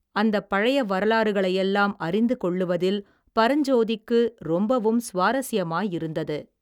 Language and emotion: Tamil, neutral